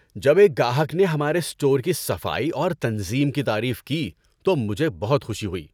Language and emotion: Urdu, happy